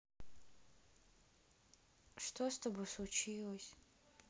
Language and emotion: Russian, sad